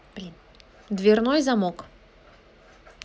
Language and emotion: Russian, neutral